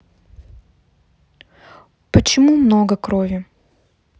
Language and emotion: Russian, neutral